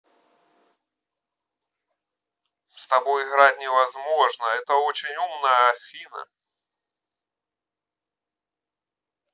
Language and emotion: Russian, neutral